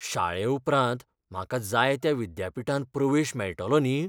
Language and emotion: Goan Konkani, fearful